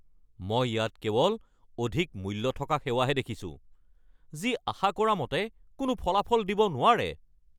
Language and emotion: Assamese, angry